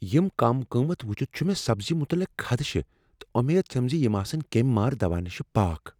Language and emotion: Kashmiri, fearful